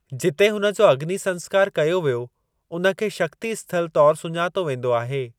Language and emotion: Sindhi, neutral